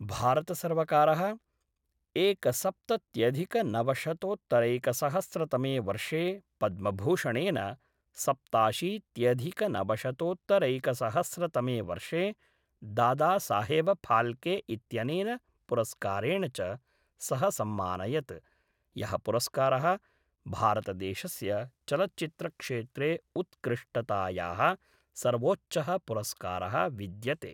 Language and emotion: Sanskrit, neutral